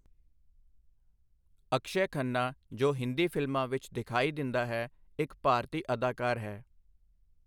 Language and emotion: Punjabi, neutral